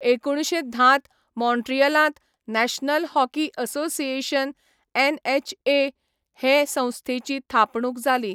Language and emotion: Goan Konkani, neutral